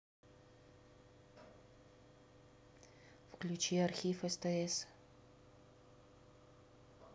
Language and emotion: Russian, neutral